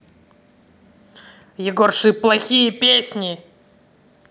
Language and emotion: Russian, angry